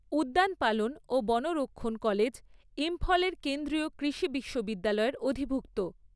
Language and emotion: Bengali, neutral